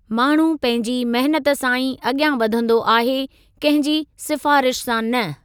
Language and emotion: Sindhi, neutral